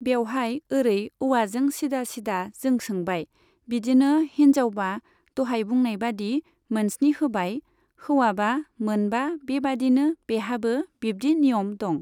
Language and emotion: Bodo, neutral